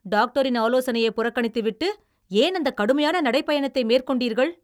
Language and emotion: Tamil, angry